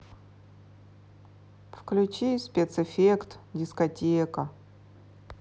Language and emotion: Russian, sad